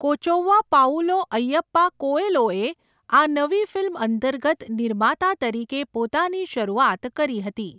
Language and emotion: Gujarati, neutral